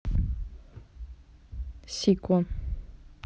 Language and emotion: Russian, neutral